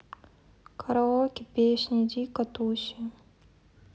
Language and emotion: Russian, sad